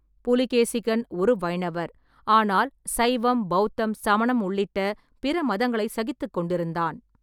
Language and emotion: Tamil, neutral